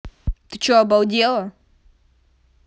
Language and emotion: Russian, angry